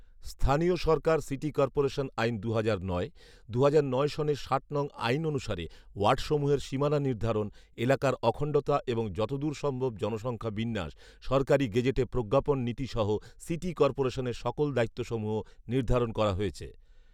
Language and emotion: Bengali, neutral